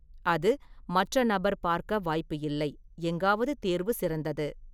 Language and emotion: Tamil, neutral